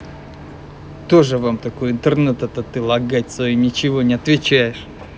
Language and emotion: Russian, angry